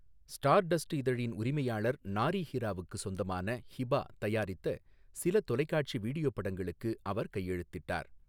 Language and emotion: Tamil, neutral